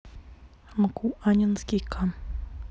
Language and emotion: Russian, neutral